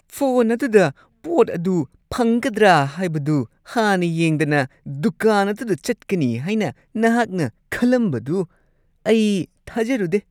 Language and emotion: Manipuri, disgusted